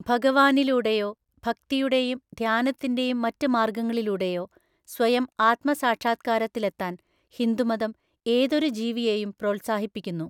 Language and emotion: Malayalam, neutral